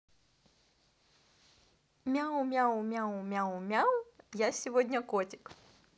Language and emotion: Russian, positive